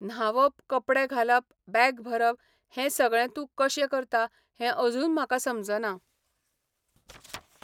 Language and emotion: Goan Konkani, neutral